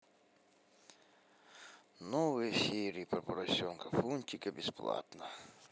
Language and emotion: Russian, sad